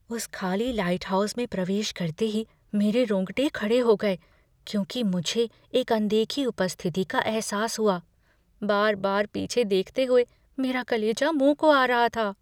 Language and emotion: Hindi, fearful